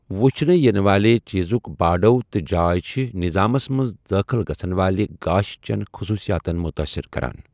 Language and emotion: Kashmiri, neutral